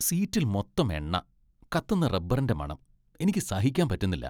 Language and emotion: Malayalam, disgusted